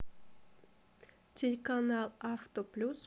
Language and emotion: Russian, neutral